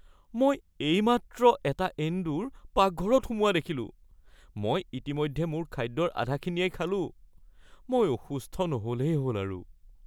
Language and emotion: Assamese, fearful